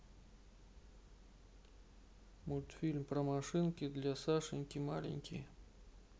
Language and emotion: Russian, neutral